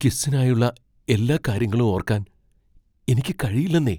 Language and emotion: Malayalam, fearful